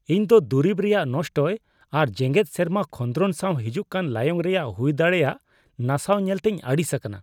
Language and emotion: Santali, disgusted